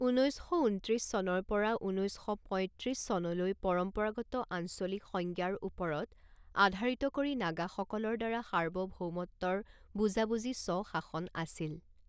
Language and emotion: Assamese, neutral